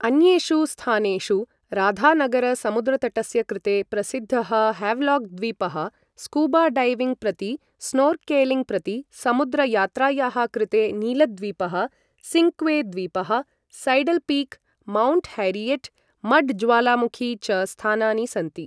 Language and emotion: Sanskrit, neutral